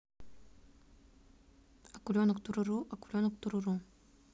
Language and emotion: Russian, neutral